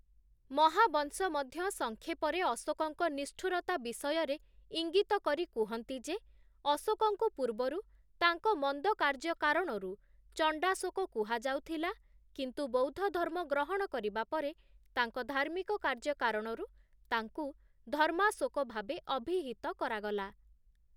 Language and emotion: Odia, neutral